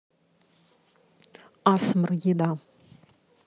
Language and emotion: Russian, neutral